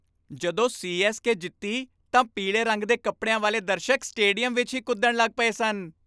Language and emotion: Punjabi, happy